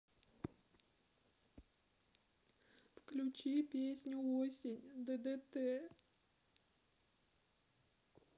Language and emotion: Russian, sad